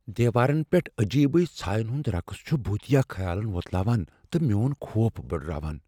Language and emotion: Kashmiri, fearful